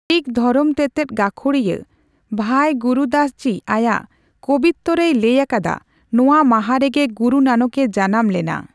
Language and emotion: Santali, neutral